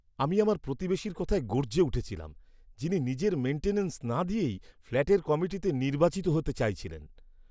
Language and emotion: Bengali, disgusted